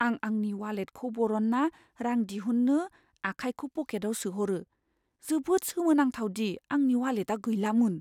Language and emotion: Bodo, fearful